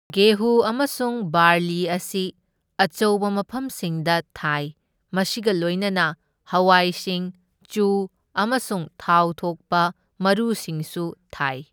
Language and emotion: Manipuri, neutral